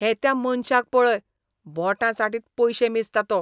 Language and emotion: Goan Konkani, disgusted